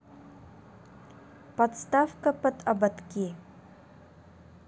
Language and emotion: Russian, neutral